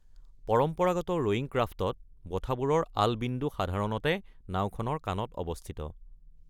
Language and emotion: Assamese, neutral